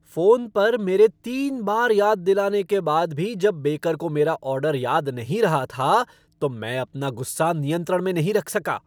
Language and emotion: Hindi, angry